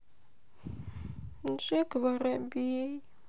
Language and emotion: Russian, sad